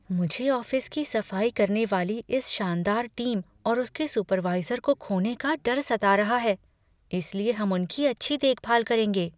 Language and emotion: Hindi, fearful